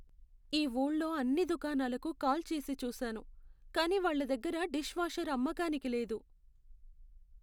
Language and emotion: Telugu, sad